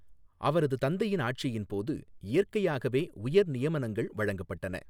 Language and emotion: Tamil, neutral